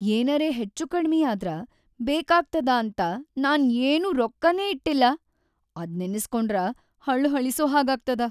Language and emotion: Kannada, sad